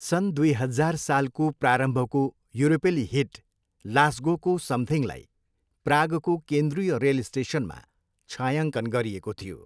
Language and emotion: Nepali, neutral